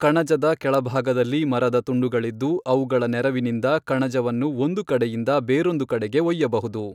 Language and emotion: Kannada, neutral